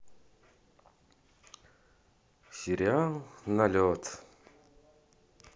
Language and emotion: Russian, sad